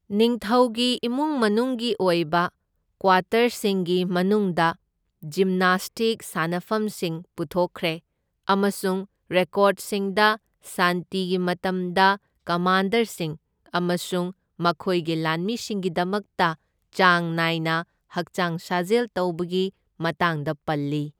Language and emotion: Manipuri, neutral